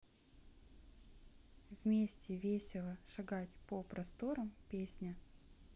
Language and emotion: Russian, neutral